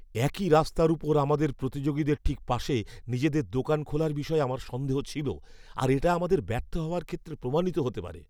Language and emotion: Bengali, fearful